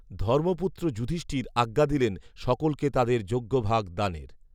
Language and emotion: Bengali, neutral